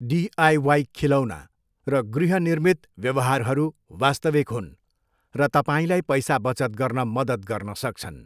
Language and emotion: Nepali, neutral